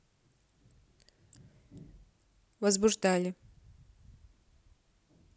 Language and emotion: Russian, neutral